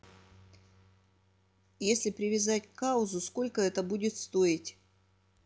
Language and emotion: Russian, neutral